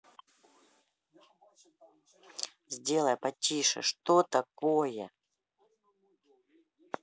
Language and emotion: Russian, angry